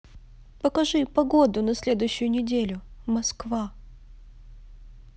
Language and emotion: Russian, sad